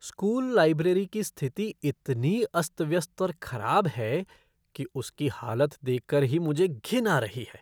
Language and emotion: Hindi, disgusted